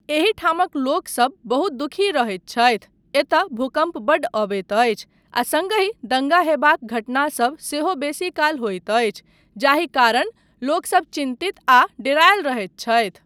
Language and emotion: Maithili, neutral